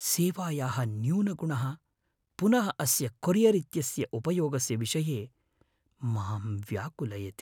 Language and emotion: Sanskrit, fearful